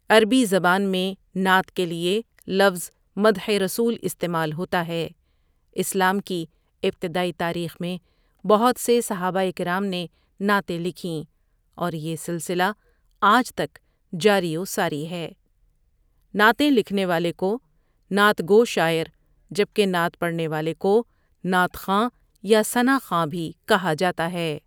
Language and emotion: Urdu, neutral